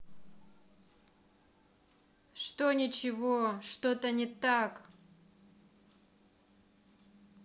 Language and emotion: Russian, angry